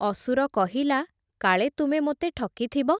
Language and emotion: Odia, neutral